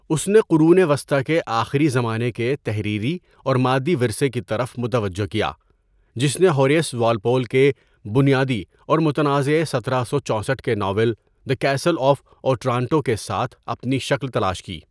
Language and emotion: Urdu, neutral